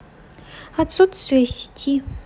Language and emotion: Russian, neutral